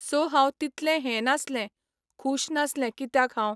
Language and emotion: Goan Konkani, neutral